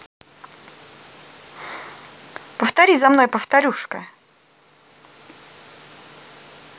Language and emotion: Russian, positive